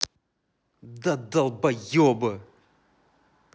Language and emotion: Russian, angry